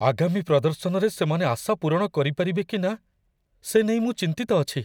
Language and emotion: Odia, fearful